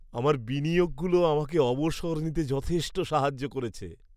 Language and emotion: Bengali, happy